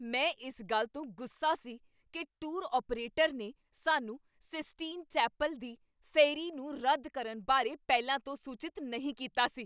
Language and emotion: Punjabi, angry